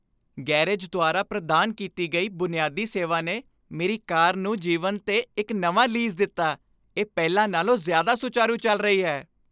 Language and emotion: Punjabi, happy